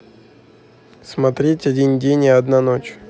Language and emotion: Russian, neutral